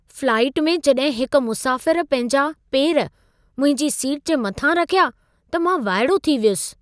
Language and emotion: Sindhi, surprised